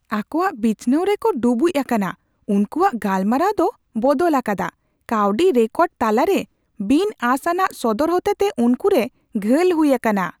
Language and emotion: Santali, surprised